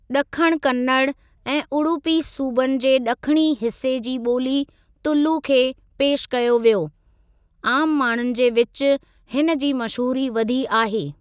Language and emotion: Sindhi, neutral